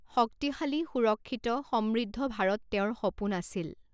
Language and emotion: Assamese, neutral